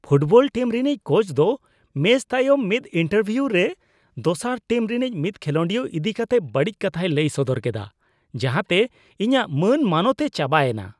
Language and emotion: Santali, disgusted